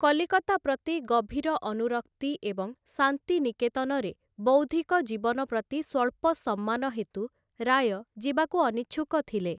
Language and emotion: Odia, neutral